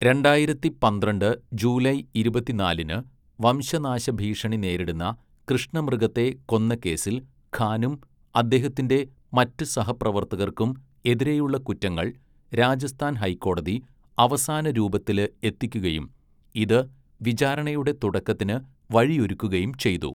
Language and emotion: Malayalam, neutral